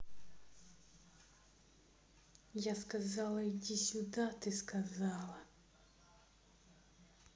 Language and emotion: Russian, angry